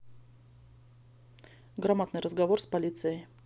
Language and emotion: Russian, neutral